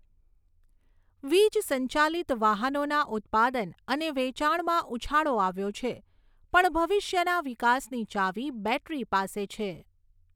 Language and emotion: Gujarati, neutral